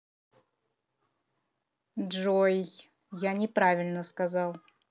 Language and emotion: Russian, neutral